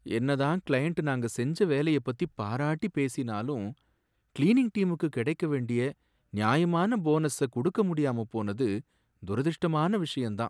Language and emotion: Tamil, sad